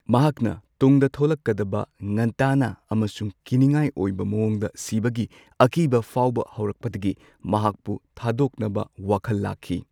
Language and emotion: Manipuri, neutral